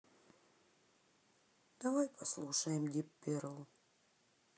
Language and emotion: Russian, sad